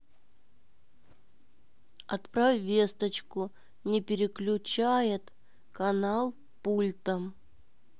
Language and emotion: Russian, neutral